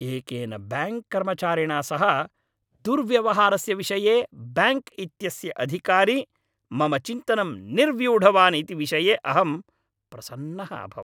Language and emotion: Sanskrit, happy